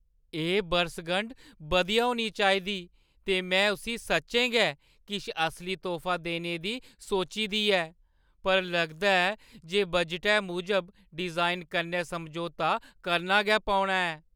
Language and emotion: Dogri, sad